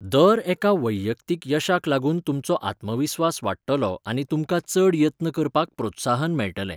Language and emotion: Goan Konkani, neutral